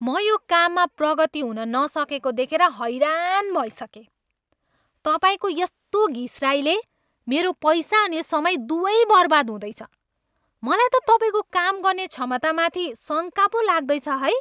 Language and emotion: Nepali, angry